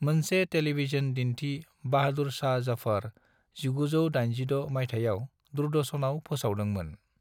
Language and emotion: Bodo, neutral